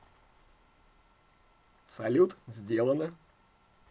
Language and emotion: Russian, positive